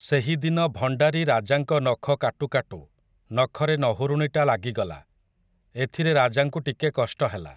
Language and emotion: Odia, neutral